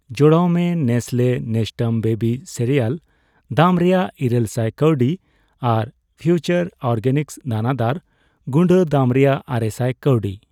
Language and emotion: Santali, neutral